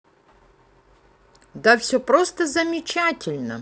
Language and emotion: Russian, positive